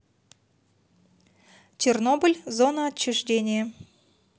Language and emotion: Russian, neutral